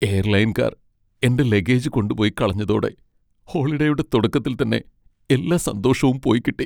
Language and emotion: Malayalam, sad